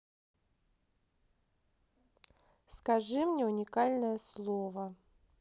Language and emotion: Russian, neutral